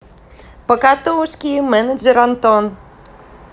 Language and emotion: Russian, positive